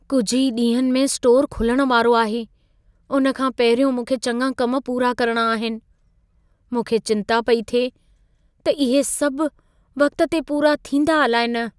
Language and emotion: Sindhi, fearful